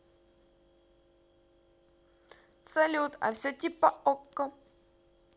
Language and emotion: Russian, positive